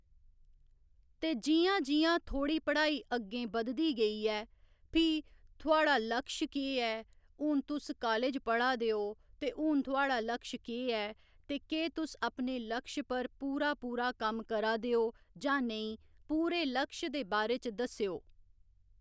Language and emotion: Dogri, neutral